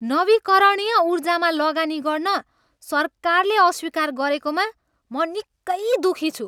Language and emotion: Nepali, angry